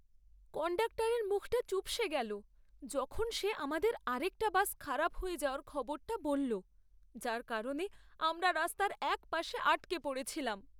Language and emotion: Bengali, sad